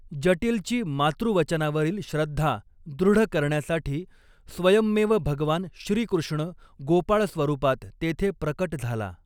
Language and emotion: Marathi, neutral